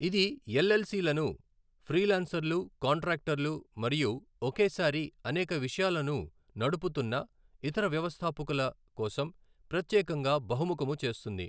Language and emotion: Telugu, neutral